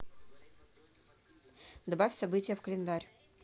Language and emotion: Russian, neutral